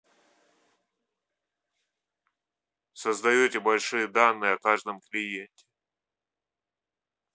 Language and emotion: Russian, neutral